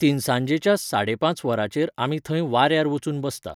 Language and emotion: Goan Konkani, neutral